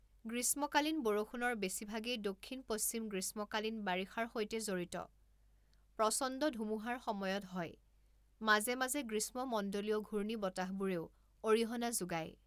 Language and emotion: Assamese, neutral